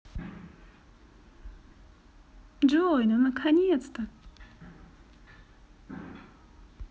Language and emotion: Russian, positive